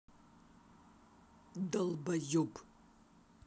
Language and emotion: Russian, angry